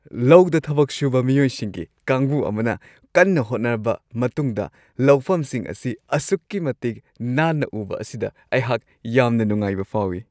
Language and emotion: Manipuri, happy